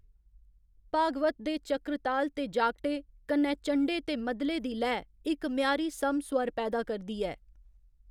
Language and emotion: Dogri, neutral